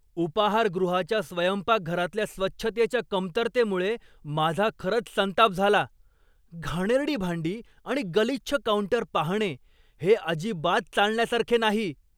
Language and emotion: Marathi, angry